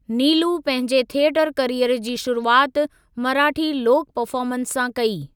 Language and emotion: Sindhi, neutral